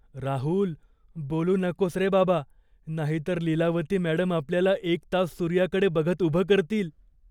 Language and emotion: Marathi, fearful